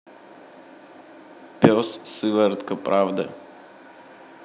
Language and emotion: Russian, neutral